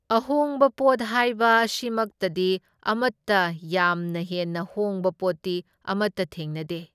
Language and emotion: Manipuri, neutral